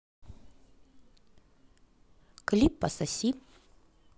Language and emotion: Russian, positive